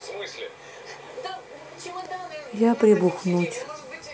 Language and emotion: Russian, sad